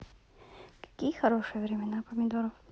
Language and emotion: Russian, neutral